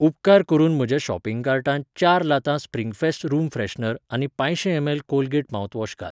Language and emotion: Goan Konkani, neutral